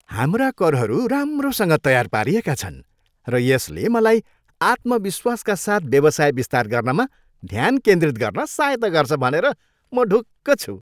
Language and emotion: Nepali, happy